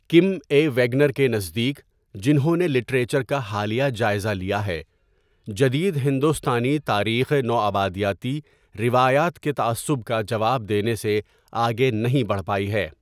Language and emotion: Urdu, neutral